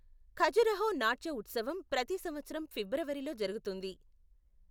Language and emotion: Telugu, neutral